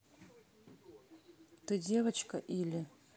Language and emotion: Russian, neutral